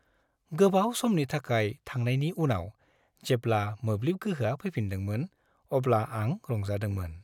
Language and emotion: Bodo, happy